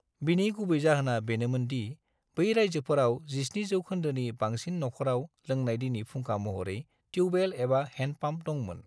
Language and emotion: Bodo, neutral